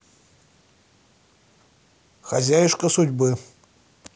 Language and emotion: Russian, neutral